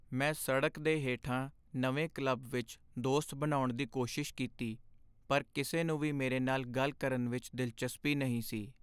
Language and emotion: Punjabi, sad